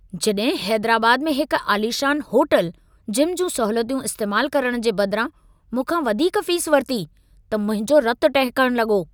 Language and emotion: Sindhi, angry